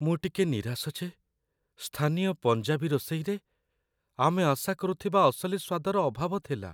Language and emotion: Odia, sad